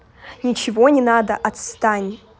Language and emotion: Russian, angry